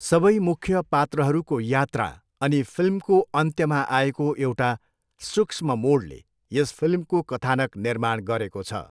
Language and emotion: Nepali, neutral